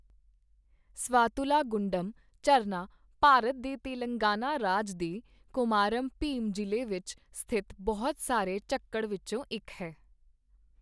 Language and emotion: Punjabi, neutral